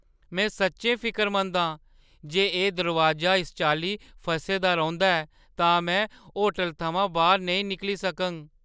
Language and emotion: Dogri, fearful